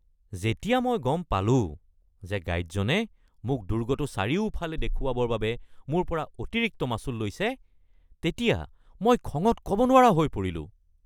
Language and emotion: Assamese, angry